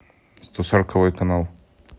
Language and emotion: Russian, neutral